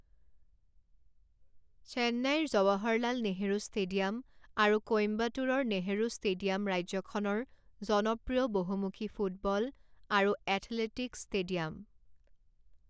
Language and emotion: Assamese, neutral